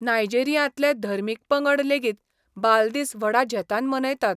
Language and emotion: Goan Konkani, neutral